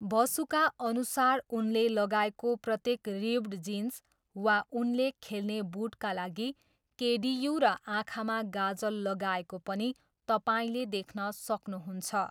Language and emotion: Nepali, neutral